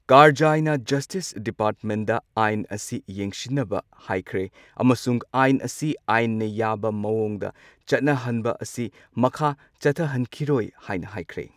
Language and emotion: Manipuri, neutral